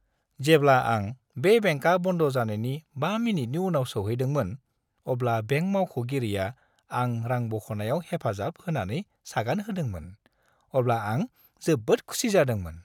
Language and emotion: Bodo, happy